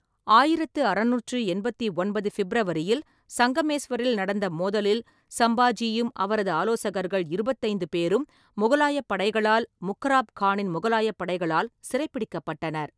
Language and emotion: Tamil, neutral